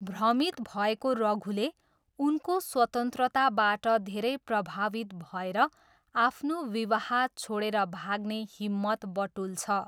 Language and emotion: Nepali, neutral